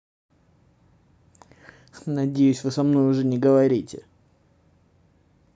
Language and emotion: Russian, angry